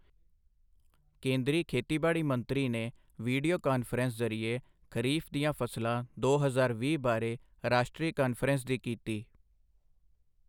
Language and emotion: Punjabi, neutral